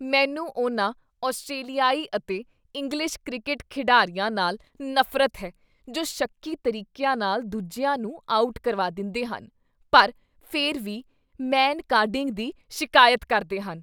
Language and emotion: Punjabi, disgusted